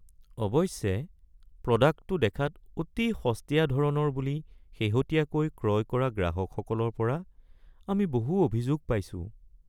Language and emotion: Assamese, sad